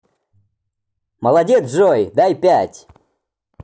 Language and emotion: Russian, positive